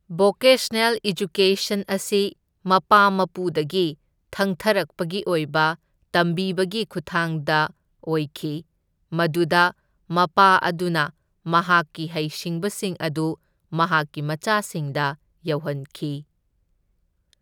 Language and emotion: Manipuri, neutral